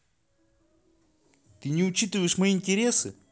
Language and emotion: Russian, angry